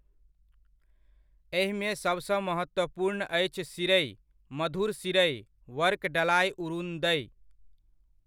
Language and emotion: Maithili, neutral